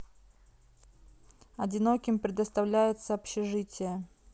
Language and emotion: Russian, neutral